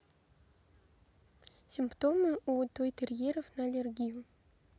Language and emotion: Russian, neutral